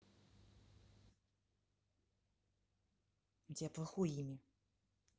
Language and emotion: Russian, angry